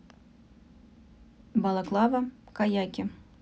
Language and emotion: Russian, neutral